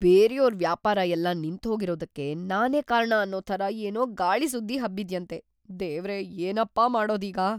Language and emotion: Kannada, fearful